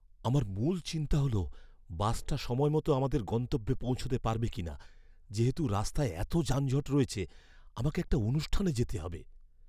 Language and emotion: Bengali, fearful